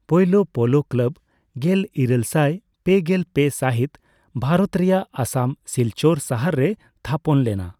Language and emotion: Santali, neutral